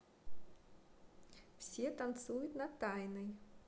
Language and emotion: Russian, positive